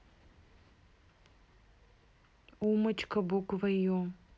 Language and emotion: Russian, neutral